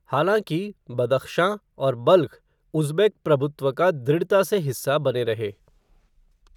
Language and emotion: Hindi, neutral